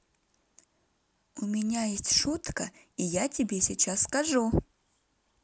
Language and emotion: Russian, positive